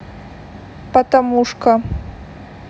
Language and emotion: Russian, neutral